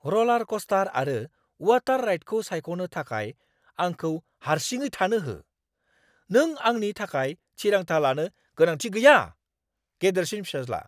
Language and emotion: Bodo, angry